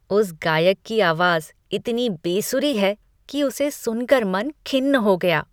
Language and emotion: Hindi, disgusted